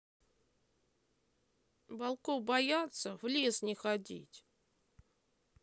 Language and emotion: Russian, sad